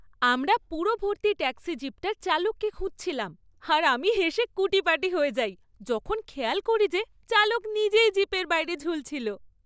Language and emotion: Bengali, happy